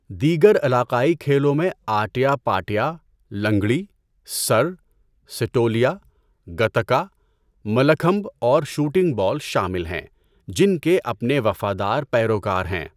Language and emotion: Urdu, neutral